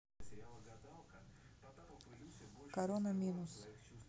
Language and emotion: Russian, neutral